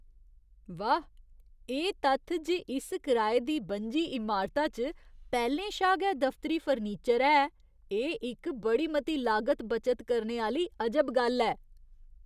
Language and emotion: Dogri, surprised